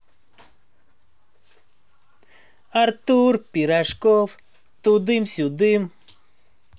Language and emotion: Russian, positive